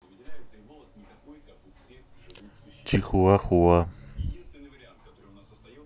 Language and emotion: Russian, neutral